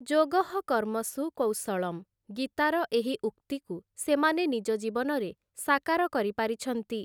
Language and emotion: Odia, neutral